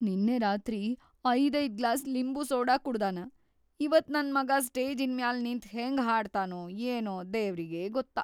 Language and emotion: Kannada, fearful